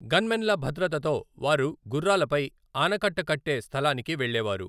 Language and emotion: Telugu, neutral